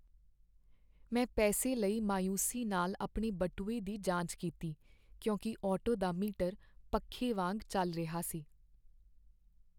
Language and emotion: Punjabi, sad